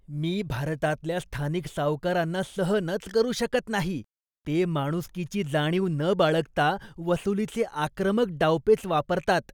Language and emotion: Marathi, disgusted